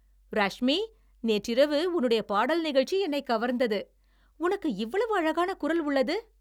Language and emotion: Tamil, happy